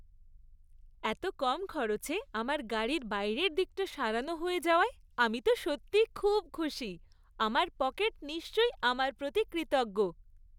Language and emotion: Bengali, happy